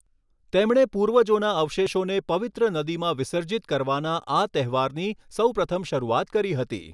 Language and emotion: Gujarati, neutral